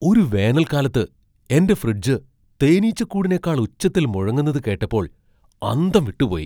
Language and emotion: Malayalam, surprised